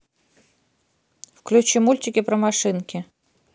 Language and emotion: Russian, neutral